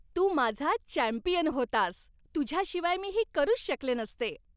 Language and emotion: Marathi, happy